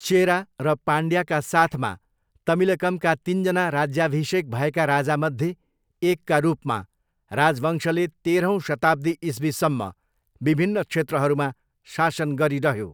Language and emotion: Nepali, neutral